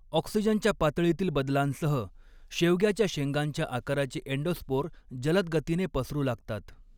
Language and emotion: Marathi, neutral